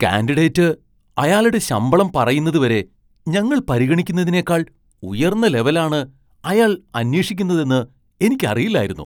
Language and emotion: Malayalam, surprised